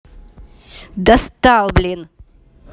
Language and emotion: Russian, angry